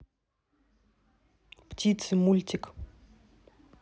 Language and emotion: Russian, neutral